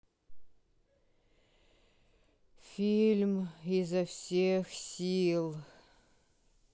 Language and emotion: Russian, sad